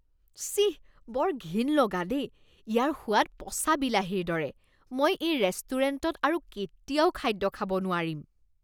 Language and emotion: Assamese, disgusted